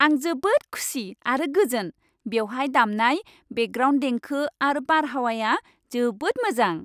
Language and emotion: Bodo, happy